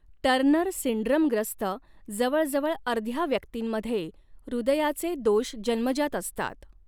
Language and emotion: Marathi, neutral